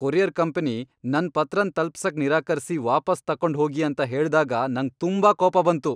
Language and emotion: Kannada, angry